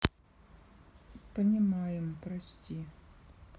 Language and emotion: Russian, sad